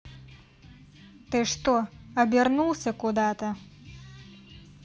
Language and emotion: Russian, angry